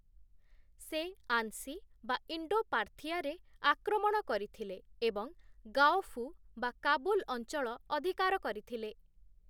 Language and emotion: Odia, neutral